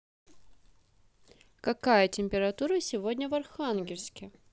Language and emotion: Russian, positive